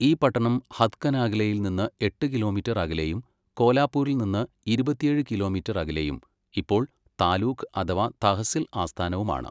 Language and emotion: Malayalam, neutral